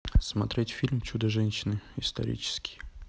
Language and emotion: Russian, neutral